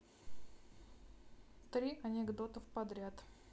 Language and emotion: Russian, neutral